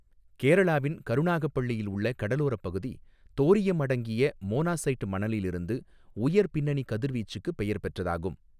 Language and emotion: Tamil, neutral